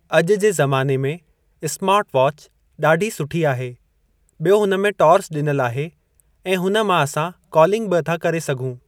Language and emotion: Sindhi, neutral